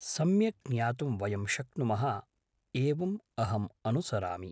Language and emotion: Sanskrit, neutral